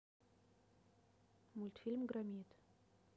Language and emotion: Russian, neutral